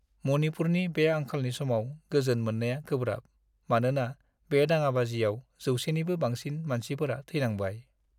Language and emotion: Bodo, sad